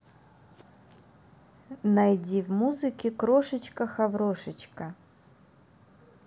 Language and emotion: Russian, neutral